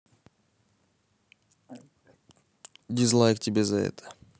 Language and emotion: Russian, neutral